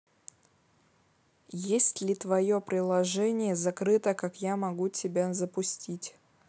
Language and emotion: Russian, neutral